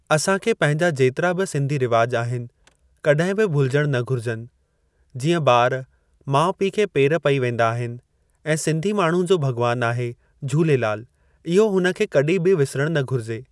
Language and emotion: Sindhi, neutral